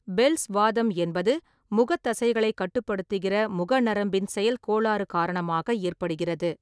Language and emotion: Tamil, neutral